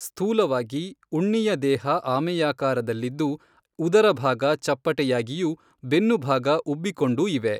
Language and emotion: Kannada, neutral